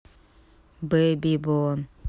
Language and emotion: Russian, neutral